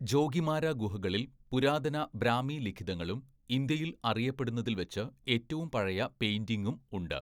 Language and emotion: Malayalam, neutral